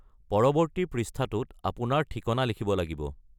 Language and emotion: Assamese, neutral